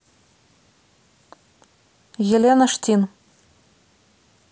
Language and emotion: Russian, neutral